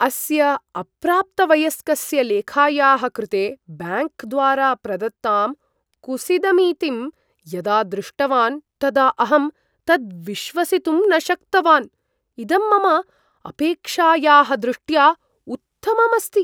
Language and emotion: Sanskrit, surprised